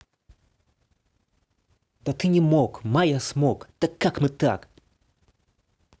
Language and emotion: Russian, angry